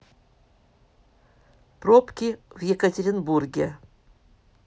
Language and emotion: Russian, neutral